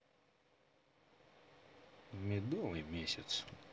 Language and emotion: Russian, neutral